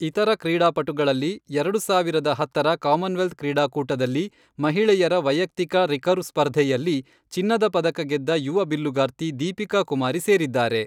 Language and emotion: Kannada, neutral